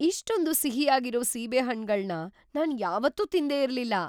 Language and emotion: Kannada, surprised